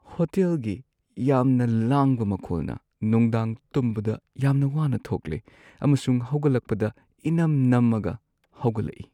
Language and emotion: Manipuri, sad